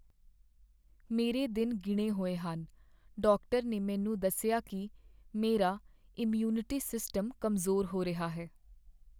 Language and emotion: Punjabi, sad